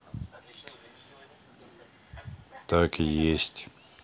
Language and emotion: Russian, neutral